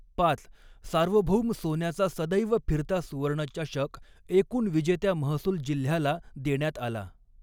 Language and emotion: Marathi, neutral